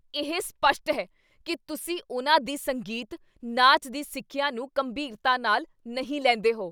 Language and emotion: Punjabi, angry